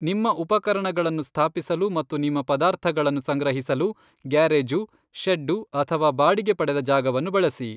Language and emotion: Kannada, neutral